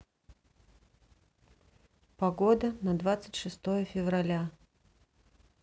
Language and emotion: Russian, neutral